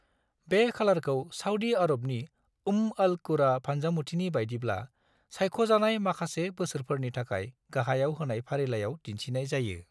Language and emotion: Bodo, neutral